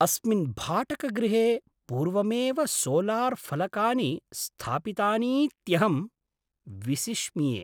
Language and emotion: Sanskrit, surprised